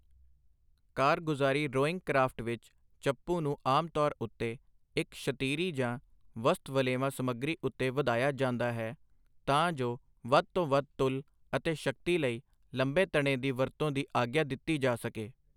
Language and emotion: Punjabi, neutral